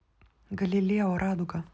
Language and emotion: Russian, neutral